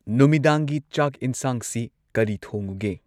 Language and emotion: Manipuri, neutral